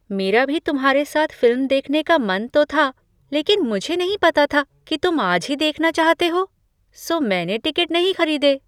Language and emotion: Hindi, surprised